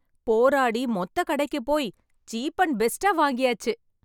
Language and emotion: Tamil, happy